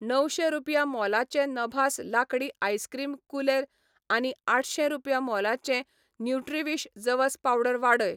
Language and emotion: Goan Konkani, neutral